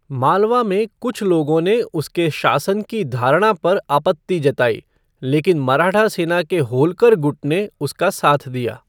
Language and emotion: Hindi, neutral